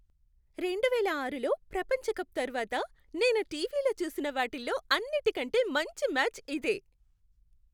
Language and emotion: Telugu, happy